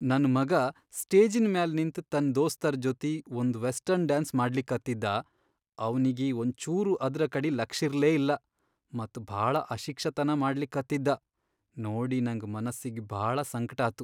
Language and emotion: Kannada, sad